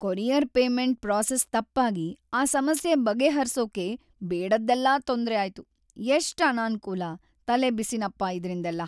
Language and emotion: Kannada, sad